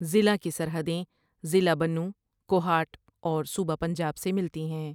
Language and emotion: Urdu, neutral